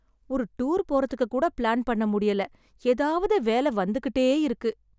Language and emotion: Tamil, sad